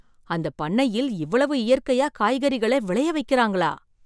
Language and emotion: Tamil, surprised